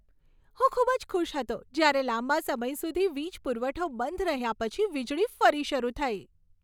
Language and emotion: Gujarati, happy